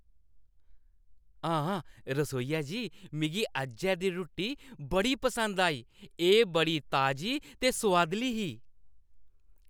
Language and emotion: Dogri, happy